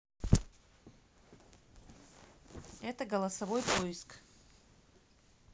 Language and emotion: Russian, neutral